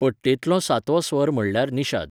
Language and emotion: Goan Konkani, neutral